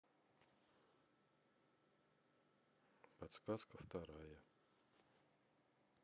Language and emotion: Russian, neutral